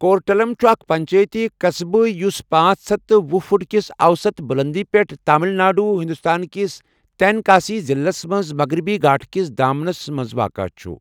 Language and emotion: Kashmiri, neutral